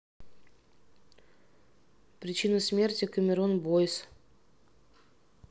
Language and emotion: Russian, neutral